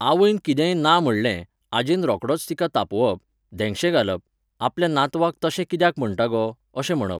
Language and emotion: Goan Konkani, neutral